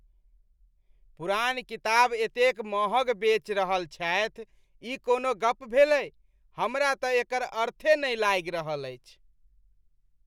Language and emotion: Maithili, disgusted